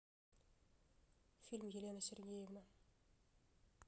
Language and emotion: Russian, neutral